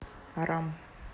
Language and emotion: Russian, neutral